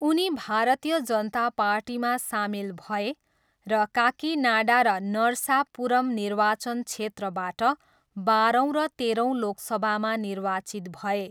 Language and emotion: Nepali, neutral